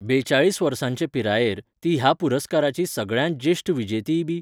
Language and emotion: Goan Konkani, neutral